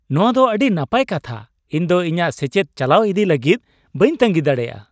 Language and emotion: Santali, happy